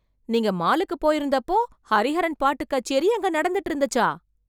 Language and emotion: Tamil, surprised